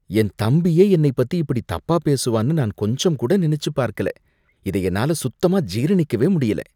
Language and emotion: Tamil, disgusted